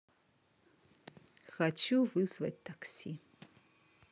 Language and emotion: Russian, neutral